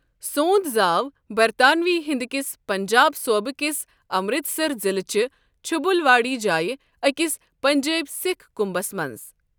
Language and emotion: Kashmiri, neutral